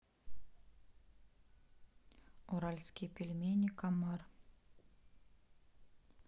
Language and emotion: Russian, neutral